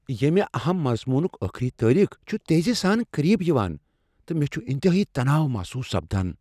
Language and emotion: Kashmiri, fearful